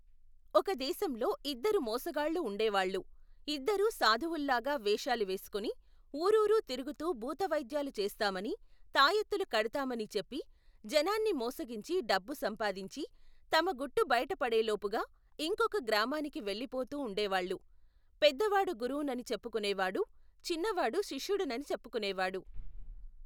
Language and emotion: Telugu, neutral